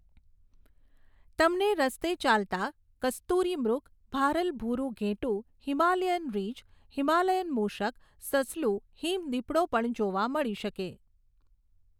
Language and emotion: Gujarati, neutral